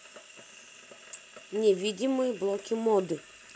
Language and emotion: Russian, neutral